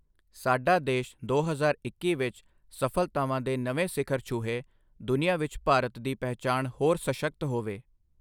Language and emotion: Punjabi, neutral